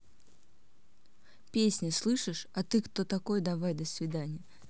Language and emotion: Russian, neutral